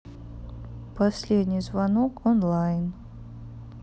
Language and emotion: Russian, neutral